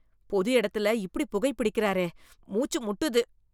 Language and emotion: Tamil, disgusted